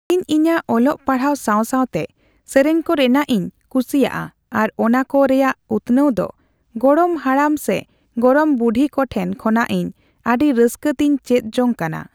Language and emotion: Santali, neutral